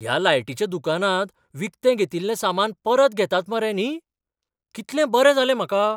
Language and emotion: Goan Konkani, surprised